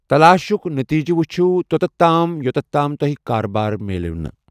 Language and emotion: Kashmiri, neutral